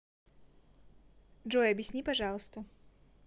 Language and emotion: Russian, neutral